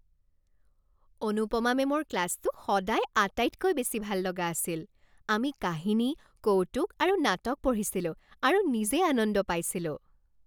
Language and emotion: Assamese, happy